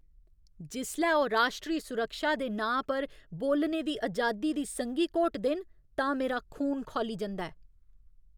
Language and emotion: Dogri, angry